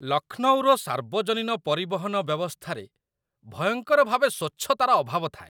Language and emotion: Odia, disgusted